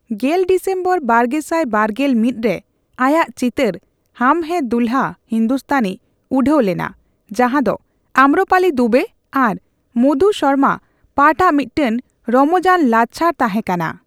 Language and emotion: Santali, neutral